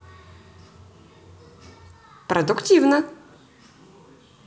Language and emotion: Russian, positive